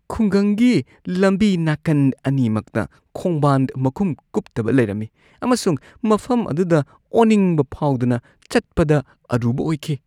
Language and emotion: Manipuri, disgusted